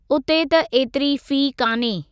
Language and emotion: Sindhi, neutral